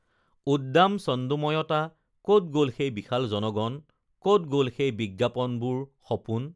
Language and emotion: Assamese, neutral